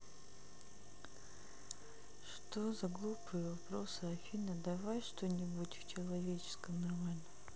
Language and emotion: Russian, sad